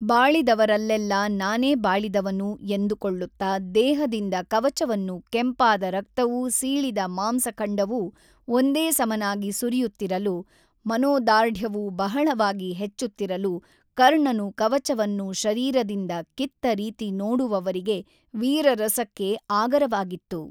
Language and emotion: Kannada, neutral